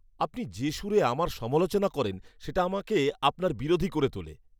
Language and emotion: Bengali, angry